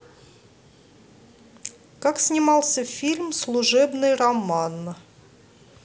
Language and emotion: Russian, neutral